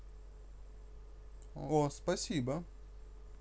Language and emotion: Russian, positive